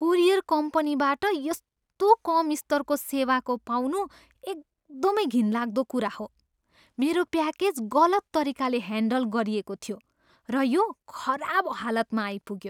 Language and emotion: Nepali, disgusted